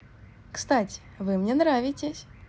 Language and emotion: Russian, positive